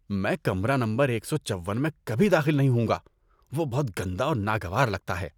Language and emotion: Urdu, disgusted